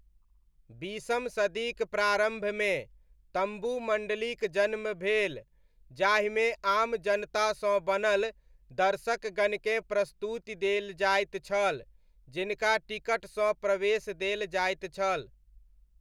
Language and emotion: Maithili, neutral